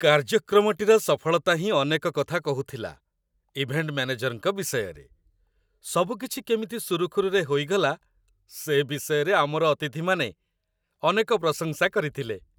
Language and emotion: Odia, happy